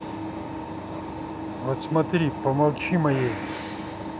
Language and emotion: Russian, angry